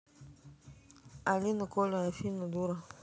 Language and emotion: Russian, neutral